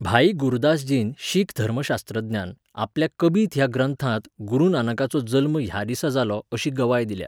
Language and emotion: Goan Konkani, neutral